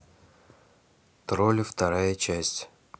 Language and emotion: Russian, neutral